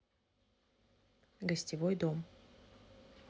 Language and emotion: Russian, neutral